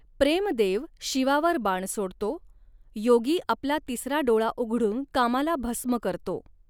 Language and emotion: Marathi, neutral